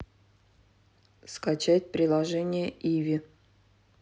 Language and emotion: Russian, neutral